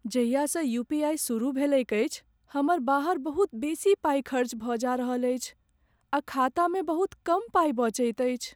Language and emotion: Maithili, sad